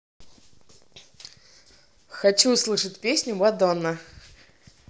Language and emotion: Russian, positive